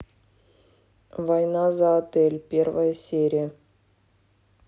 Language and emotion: Russian, neutral